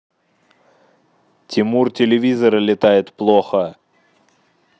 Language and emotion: Russian, neutral